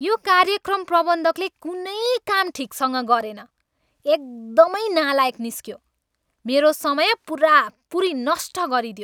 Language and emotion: Nepali, angry